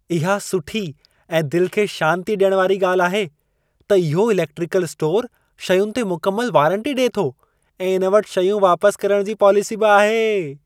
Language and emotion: Sindhi, happy